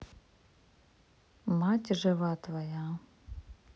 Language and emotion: Russian, neutral